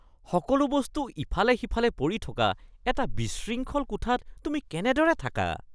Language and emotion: Assamese, disgusted